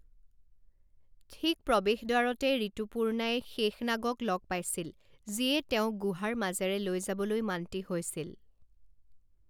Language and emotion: Assamese, neutral